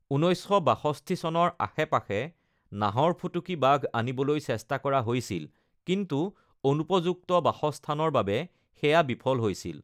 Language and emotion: Assamese, neutral